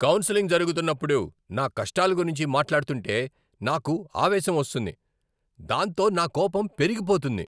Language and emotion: Telugu, angry